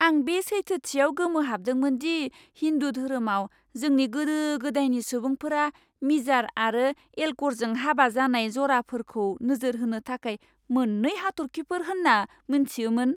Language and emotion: Bodo, surprised